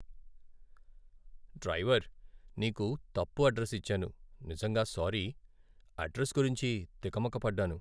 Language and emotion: Telugu, sad